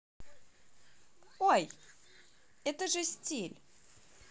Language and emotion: Russian, positive